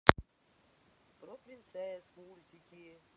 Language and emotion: Russian, neutral